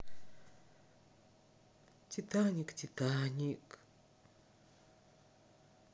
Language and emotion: Russian, sad